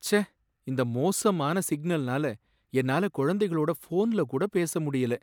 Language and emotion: Tamil, sad